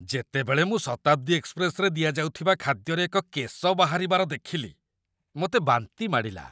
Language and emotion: Odia, disgusted